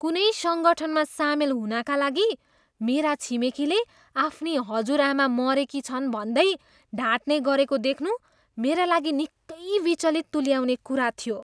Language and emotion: Nepali, disgusted